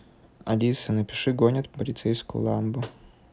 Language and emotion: Russian, neutral